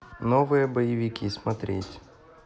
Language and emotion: Russian, neutral